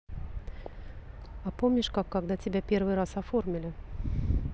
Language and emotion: Russian, neutral